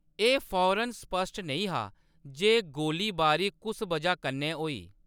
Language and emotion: Dogri, neutral